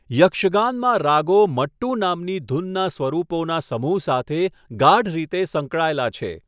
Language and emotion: Gujarati, neutral